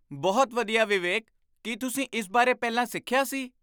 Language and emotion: Punjabi, surprised